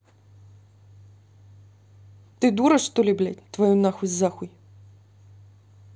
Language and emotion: Russian, angry